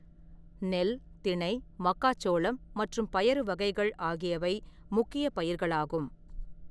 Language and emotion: Tamil, neutral